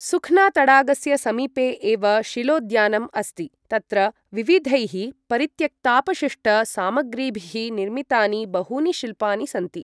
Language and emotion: Sanskrit, neutral